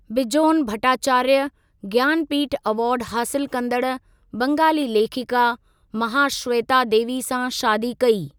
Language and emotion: Sindhi, neutral